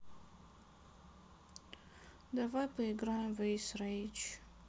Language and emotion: Russian, sad